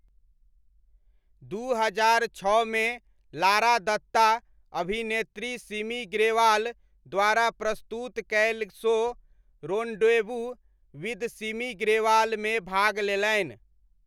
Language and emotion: Maithili, neutral